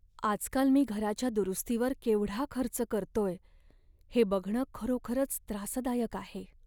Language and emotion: Marathi, sad